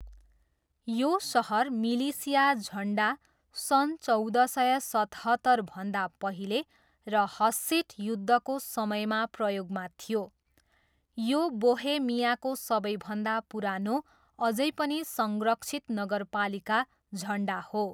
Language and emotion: Nepali, neutral